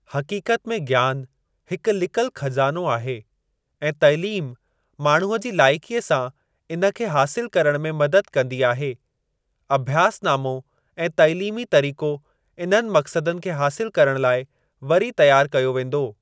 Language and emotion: Sindhi, neutral